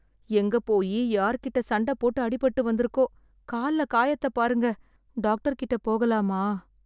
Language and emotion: Tamil, sad